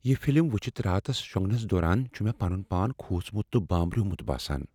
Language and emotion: Kashmiri, fearful